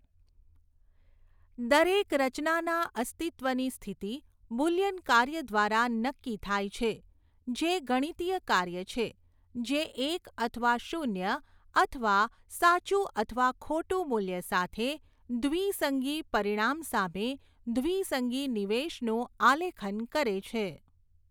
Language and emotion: Gujarati, neutral